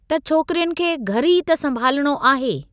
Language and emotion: Sindhi, neutral